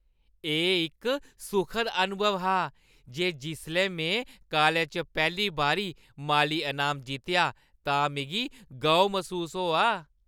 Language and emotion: Dogri, happy